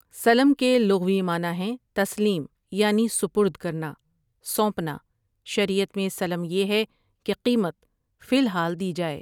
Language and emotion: Urdu, neutral